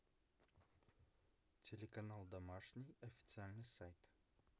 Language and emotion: Russian, neutral